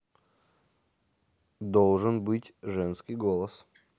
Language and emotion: Russian, neutral